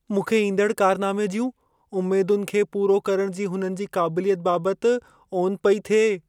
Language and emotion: Sindhi, fearful